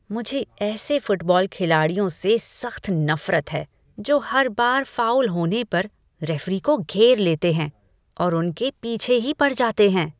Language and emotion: Hindi, disgusted